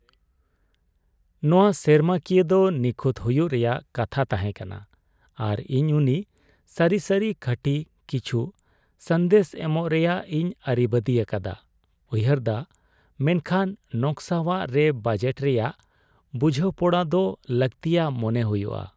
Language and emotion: Santali, sad